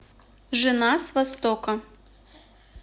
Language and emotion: Russian, neutral